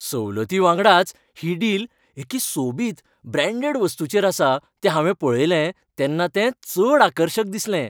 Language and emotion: Goan Konkani, happy